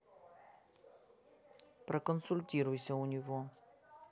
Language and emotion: Russian, neutral